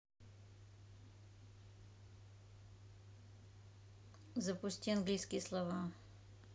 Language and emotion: Russian, neutral